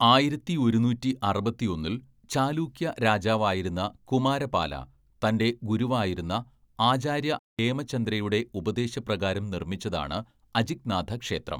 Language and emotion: Malayalam, neutral